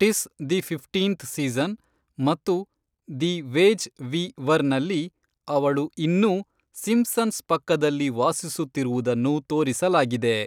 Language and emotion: Kannada, neutral